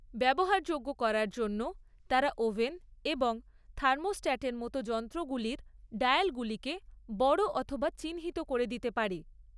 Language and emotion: Bengali, neutral